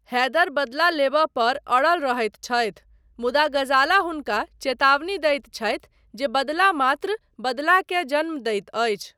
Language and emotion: Maithili, neutral